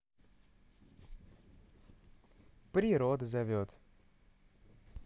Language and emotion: Russian, positive